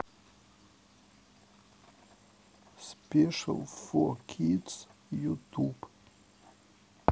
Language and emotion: Russian, sad